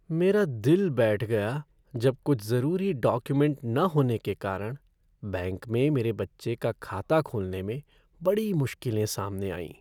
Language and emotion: Hindi, sad